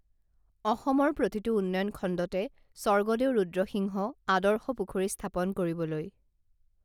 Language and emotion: Assamese, neutral